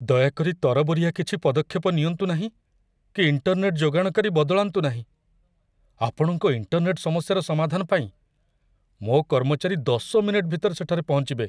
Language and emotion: Odia, fearful